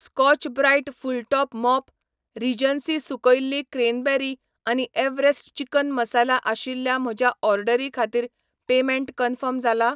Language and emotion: Goan Konkani, neutral